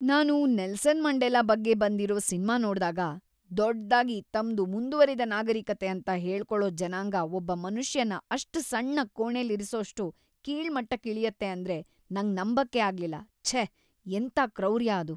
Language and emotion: Kannada, disgusted